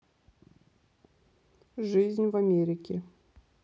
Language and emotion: Russian, neutral